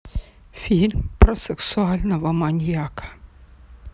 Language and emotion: Russian, neutral